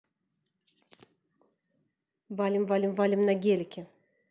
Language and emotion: Russian, positive